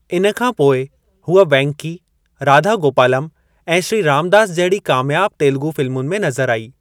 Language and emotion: Sindhi, neutral